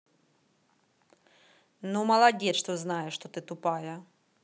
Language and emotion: Russian, angry